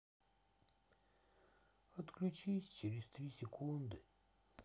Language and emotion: Russian, sad